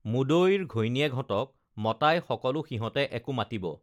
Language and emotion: Assamese, neutral